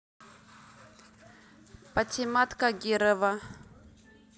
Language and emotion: Russian, neutral